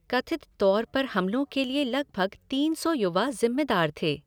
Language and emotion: Hindi, neutral